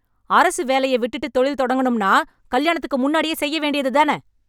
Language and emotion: Tamil, angry